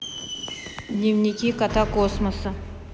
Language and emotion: Russian, neutral